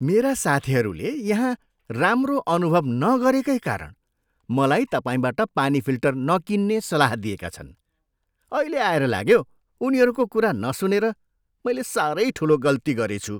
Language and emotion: Nepali, disgusted